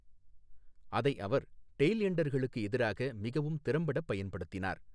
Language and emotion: Tamil, neutral